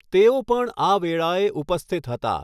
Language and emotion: Gujarati, neutral